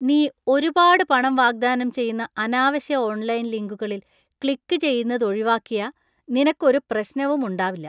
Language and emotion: Malayalam, disgusted